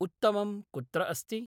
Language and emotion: Sanskrit, neutral